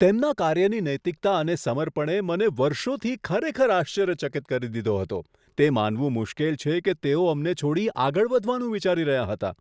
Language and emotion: Gujarati, surprised